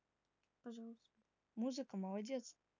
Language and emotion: Russian, positive